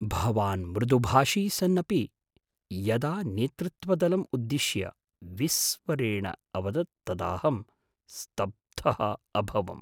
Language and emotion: Sanskrit, surprised